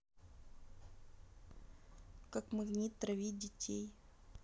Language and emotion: Russian, neutral